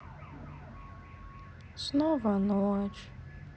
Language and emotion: Russian, sad